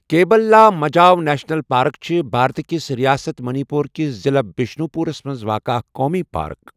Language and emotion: Kashmiri, neutral